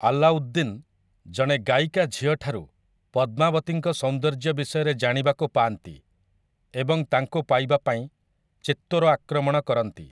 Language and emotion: Odia, neutral